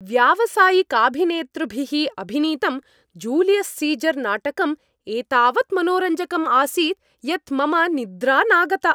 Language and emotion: Sanskrit, happy